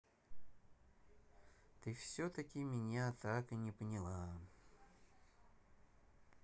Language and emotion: Russian, sad